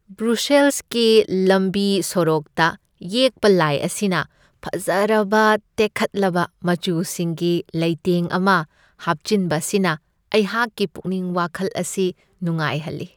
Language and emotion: Manipuri, happy